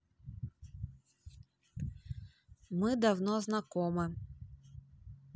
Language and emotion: Russian, neutral